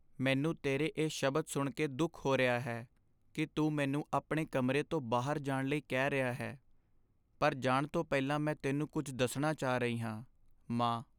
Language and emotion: Punjabi, sad